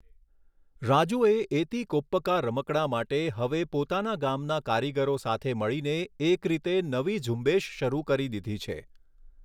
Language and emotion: Gujarati, neutral